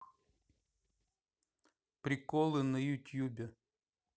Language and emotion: Russian, neutral